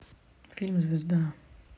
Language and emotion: Russian, neutral